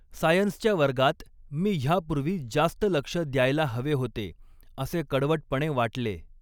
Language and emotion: Marathi, neutral